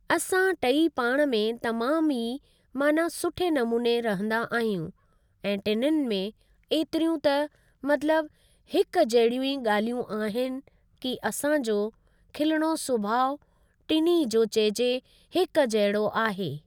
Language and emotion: Sindhi, neutral